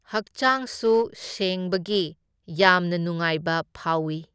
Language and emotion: Manipuri, neutral